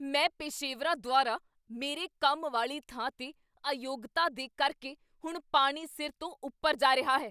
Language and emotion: Punjabi, angry